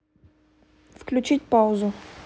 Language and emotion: Russian, neutral